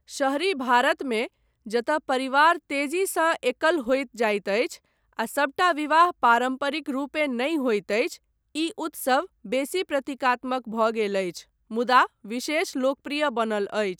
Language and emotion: Maithili, neutral